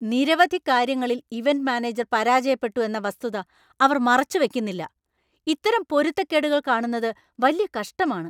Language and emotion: Malayalam, angry